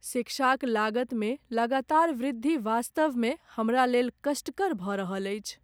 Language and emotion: Maithili, sad